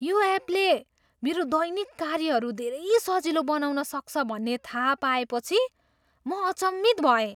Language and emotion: Nepali, surprised